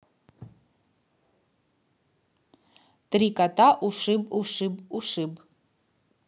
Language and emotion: Russian, neutral